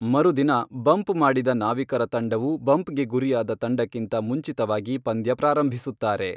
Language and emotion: Kannada, neutral